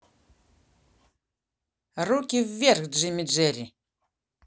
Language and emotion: Russian, positive